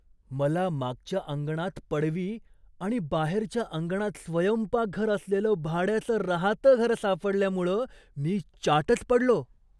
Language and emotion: Marathi, surprised